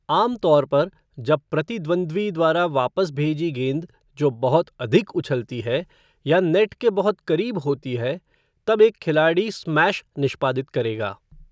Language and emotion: Hindi, neutral